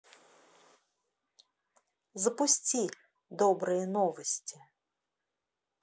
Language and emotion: Russian, positive